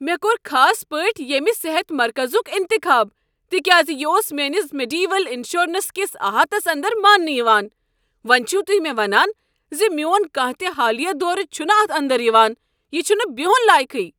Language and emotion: Kashmiri, angry